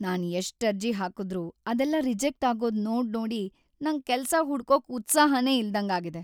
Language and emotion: Kannada, sad